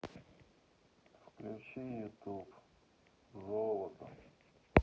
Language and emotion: Russian, neutral